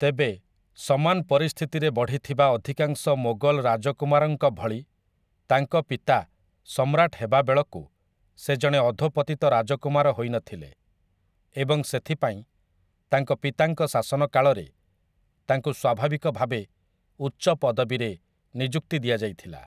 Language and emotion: Odia, neutral